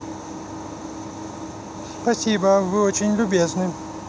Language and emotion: Russian, positive